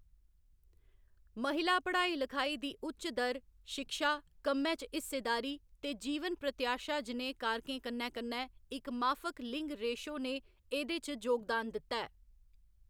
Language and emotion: Dogri, neutral